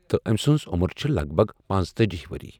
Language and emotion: Kashmiri, neutral